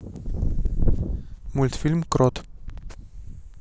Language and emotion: Russian, neutral